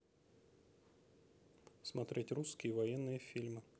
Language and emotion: Russian, neutral